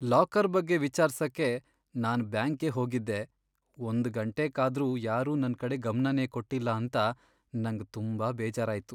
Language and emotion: Kannada, sad